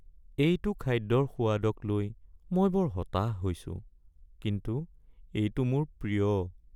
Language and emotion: Assamese, sad